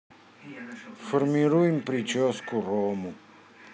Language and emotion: Russian, neutral